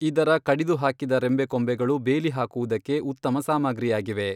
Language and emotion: Kannada, neutral